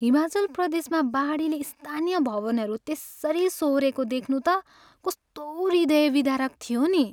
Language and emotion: Nepali, sad